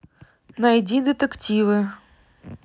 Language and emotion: Russian, neutral